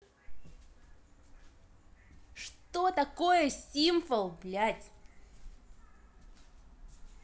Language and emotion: Russian, angry